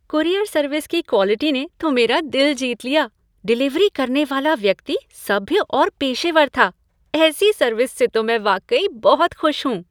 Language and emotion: Hindi, happy